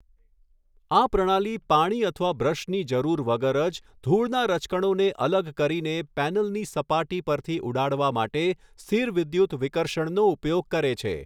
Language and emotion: Gujarati, neutral